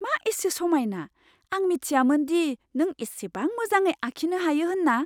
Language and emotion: Bodo, surprised